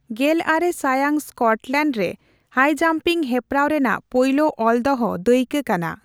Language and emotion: Santali, neutral